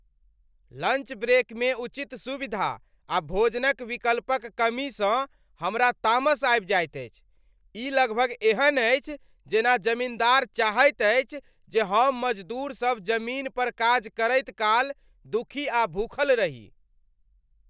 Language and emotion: Maithili, angry